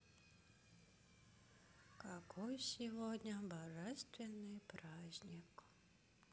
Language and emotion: Russian, sad